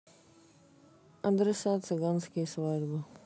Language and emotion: Russian, sad